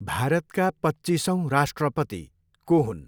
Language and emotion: Nepali, neutral